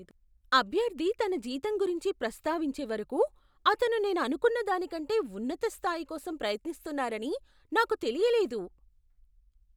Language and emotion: Telugu, surprised